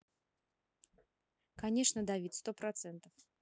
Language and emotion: Russian, neutral